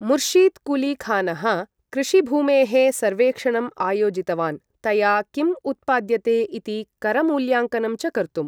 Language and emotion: Sanskrit, neutral